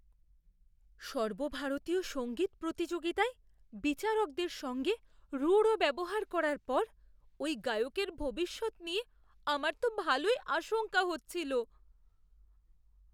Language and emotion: Bengali, fearful